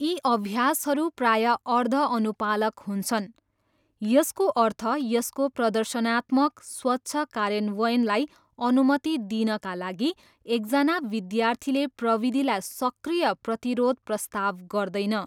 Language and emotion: Nepali, neutral